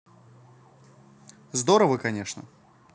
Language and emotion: Russian, positive